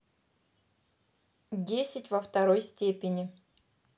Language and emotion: Russian, positive